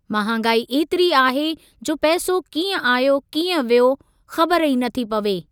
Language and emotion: Sindhi, neutral